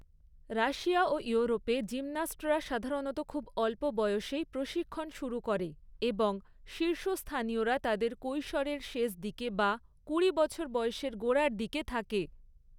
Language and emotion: Bengali, neutral